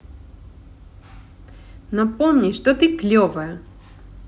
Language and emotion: Russian, positive